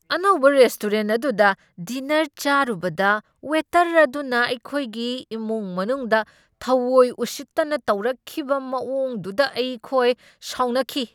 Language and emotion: Manipuri, angry